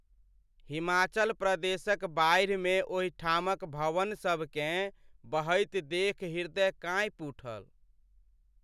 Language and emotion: Maithili, sad